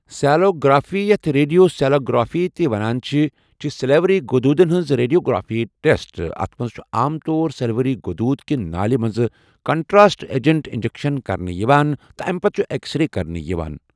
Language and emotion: Kashmiri, neutral